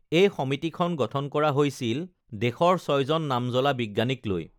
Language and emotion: Assamese, neutral